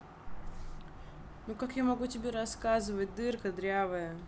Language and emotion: Russian, angry